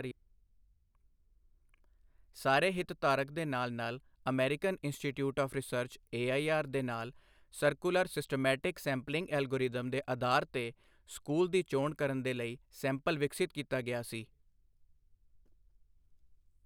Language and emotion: Punjabi, neutral